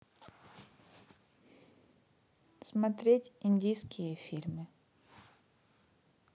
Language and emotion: Russian, neutral